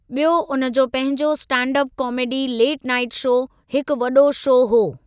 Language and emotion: Sindhi, neutral